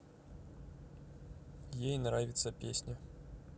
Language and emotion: Russian, neutral